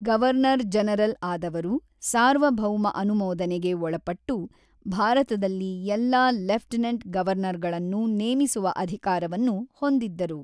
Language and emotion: Kannada, neutral